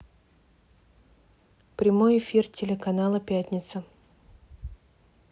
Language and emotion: Russian, neutral